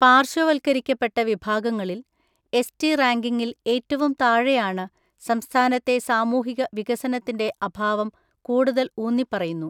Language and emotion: Malayalam, neutral